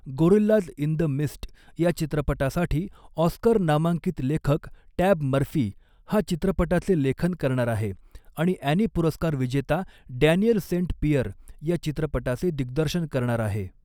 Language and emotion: Marathi, neutral